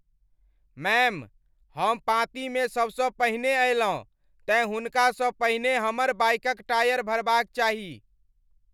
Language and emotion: Maithili, angry